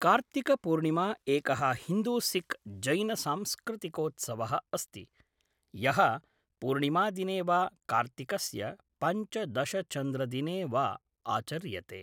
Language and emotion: Sanskrit, neutral